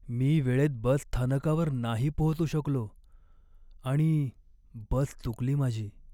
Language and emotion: Marathi, sad